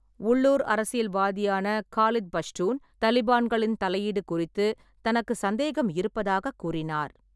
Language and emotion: Tamil, neutral